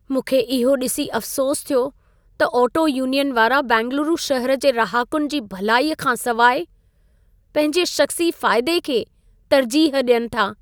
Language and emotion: Sindhi, sad